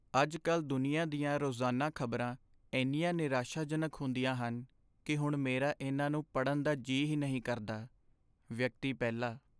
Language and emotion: Punjabi, sad